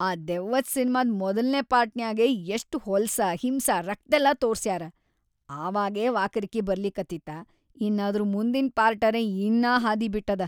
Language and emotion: Kannada, disgusted